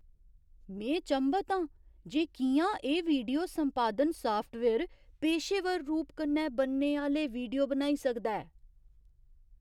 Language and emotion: Dogri, surprised